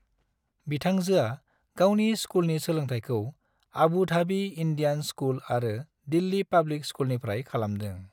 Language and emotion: Bodo, neutral